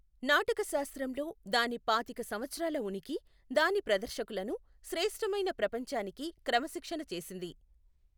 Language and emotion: Telugu, neutral